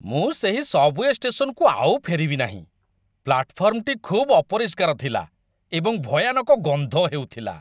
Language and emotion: Odia, disgusted